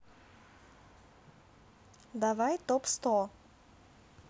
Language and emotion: Russian, neutral